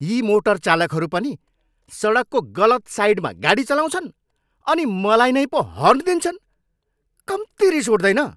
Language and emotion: Nepali, angry